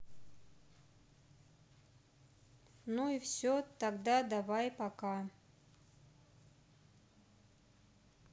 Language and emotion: Russian, neutral